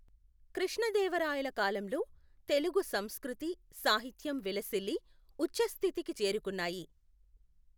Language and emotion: Telugu, neutral